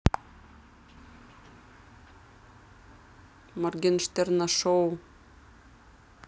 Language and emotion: Russian, neutral